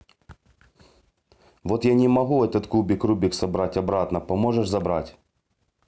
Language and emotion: Russian, neutral